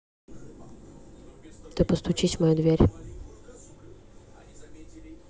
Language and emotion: Russian, neutral